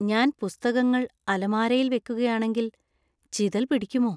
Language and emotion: Malayalam, fearful